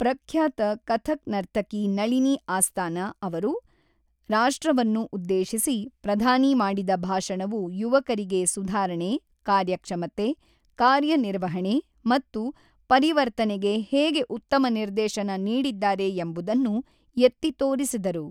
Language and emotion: Kannada, neutral